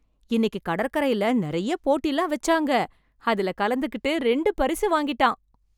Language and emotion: Tamil, happy